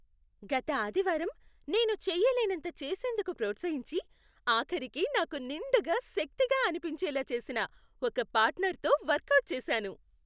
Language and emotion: Telugu, happy